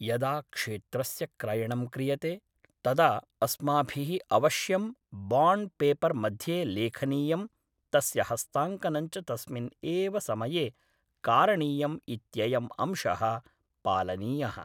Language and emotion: Sanskrit, neutral